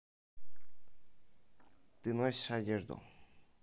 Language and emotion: Russian, neutral